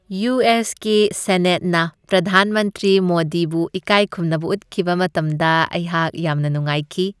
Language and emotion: Manipuri, happy